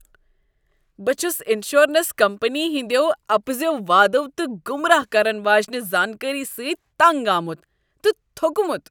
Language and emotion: Kashmiri, disgusted